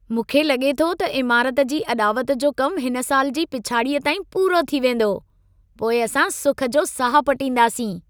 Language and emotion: Sindhi, happy